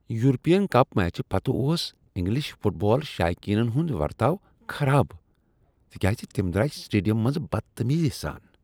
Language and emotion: Kashmiri, disgusted